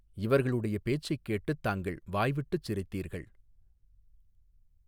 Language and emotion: Tamil, neutral